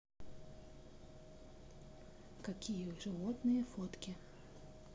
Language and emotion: Russian, neutral